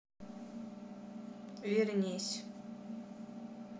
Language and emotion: Russian, neutral